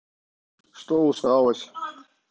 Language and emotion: Russian, neutral